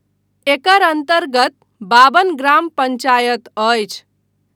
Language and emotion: Maithili, neutral